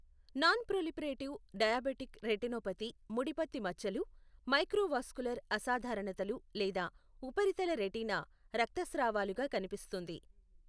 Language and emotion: Telugu, neutral